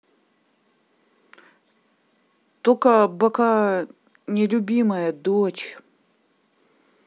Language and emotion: Russian, neutral